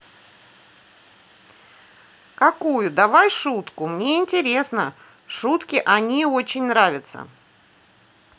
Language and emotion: Russian, positive